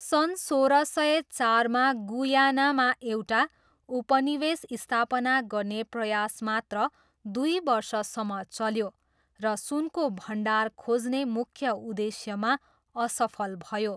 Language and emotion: Nepali, neutral